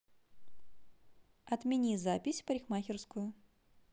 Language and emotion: Russian, neutral